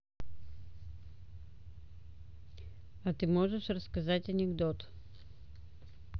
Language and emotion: Russian, neutral